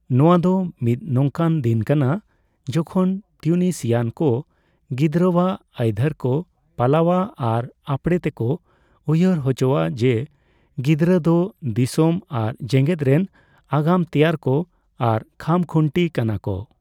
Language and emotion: Santali, neutral